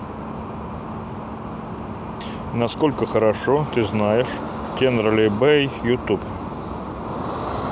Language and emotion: Russian, neutral